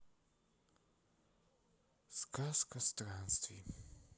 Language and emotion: Russian, sad